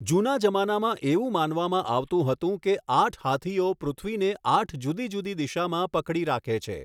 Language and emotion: Gujarati, neutral